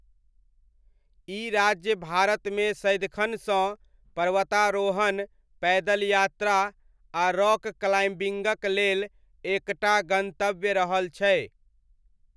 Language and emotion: Maithili, neutral